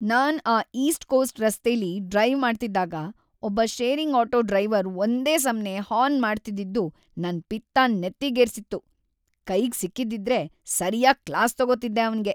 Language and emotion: Kannada, angry